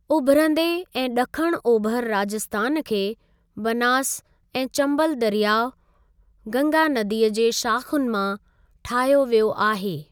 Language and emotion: Sindhi, neutral